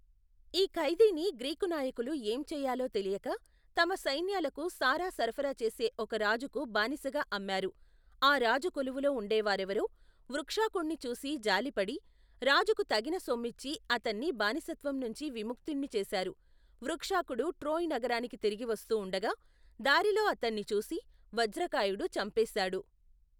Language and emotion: Telugu, neutral